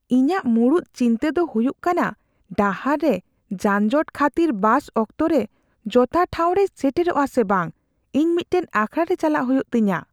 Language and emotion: Santali, fearful